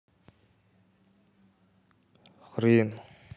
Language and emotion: Russian, neutral